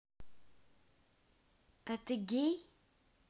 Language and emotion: Russian, neutral